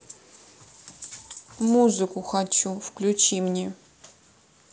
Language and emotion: Russian, neutral